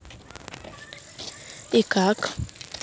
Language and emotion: Russian, neutral